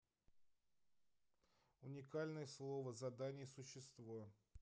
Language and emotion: Russian, neutral